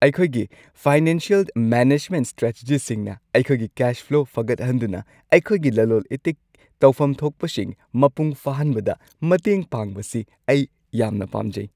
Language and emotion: Manipuri, happy